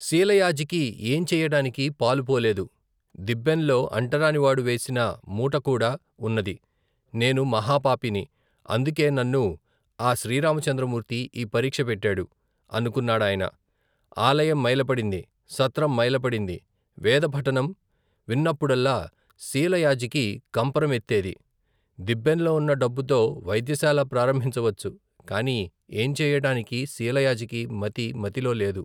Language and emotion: Telugu, neutral